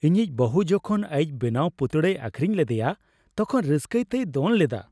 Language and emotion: Santali, happy